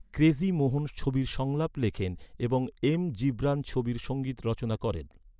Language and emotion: Bengali, neutral